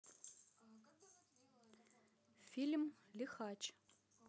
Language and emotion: Russian, neutral